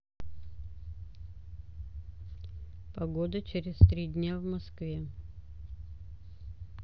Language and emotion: Russian, neutral